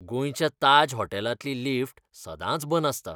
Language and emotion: Goan Konkani, disgusted